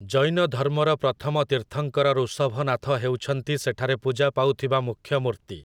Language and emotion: Odia, neutral